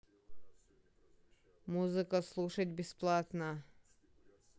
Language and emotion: Russian, neutral